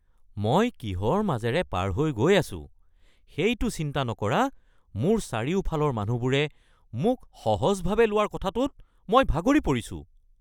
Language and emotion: Assamese, angry